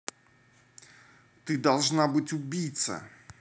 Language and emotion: Russian, angry